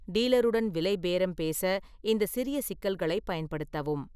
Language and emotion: Tamil, neutral